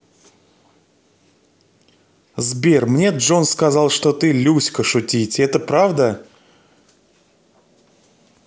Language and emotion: Russian, positive